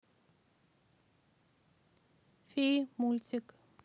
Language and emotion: Russian, neutral